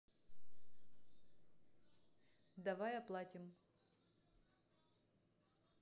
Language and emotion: Russian, neutral